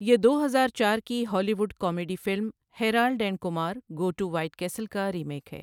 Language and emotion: Urdu, neutral